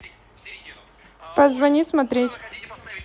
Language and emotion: Russian, neutral